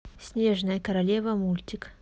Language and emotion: Russian, neutral